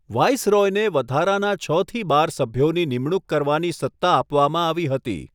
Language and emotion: Gujarati, neutral